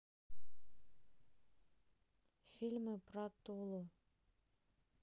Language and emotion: Russian, neutral